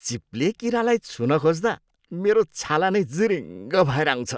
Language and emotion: Nepali, disgusted